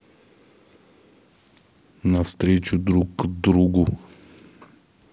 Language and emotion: Russian, neutral